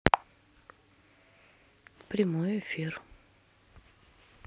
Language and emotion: Russian, neutral